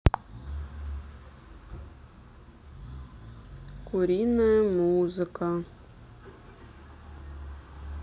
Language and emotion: Russian, neutral